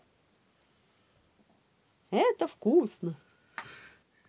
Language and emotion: Russian, positive